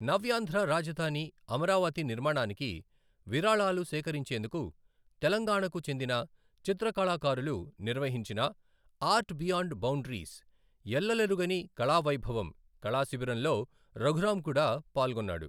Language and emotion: Telugu, neutral